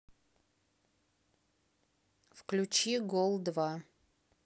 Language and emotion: Russian, neutral